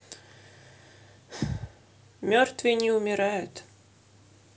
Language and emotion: Russian, sad